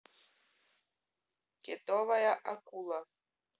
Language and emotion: Russian, neutral